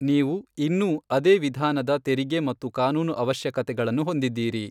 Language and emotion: Kannada, neutral